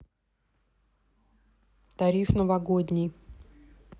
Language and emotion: Russian, neutral